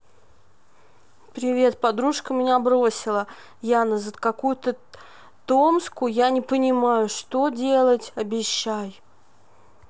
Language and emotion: Russian, sad